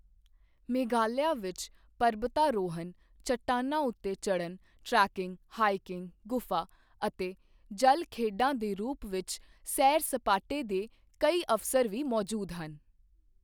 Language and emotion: Punjabi, neutral